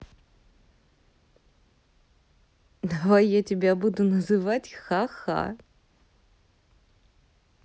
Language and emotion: Russian, positive